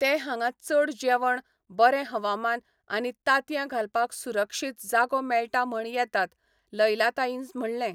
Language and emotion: Goan Konkani, neutral